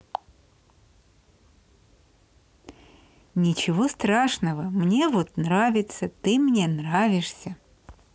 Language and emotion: Russian, positive